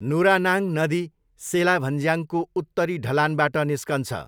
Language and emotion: Nepali, neutral